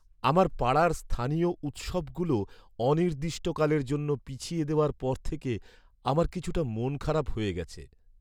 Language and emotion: Bengali, sad